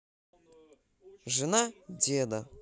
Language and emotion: Russian, positive